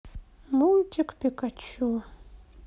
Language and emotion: Russian, sad